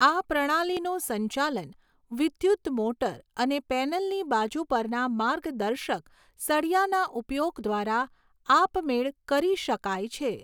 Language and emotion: Gujarati, neutral